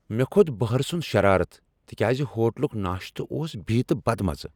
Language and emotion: Kashmiri, angry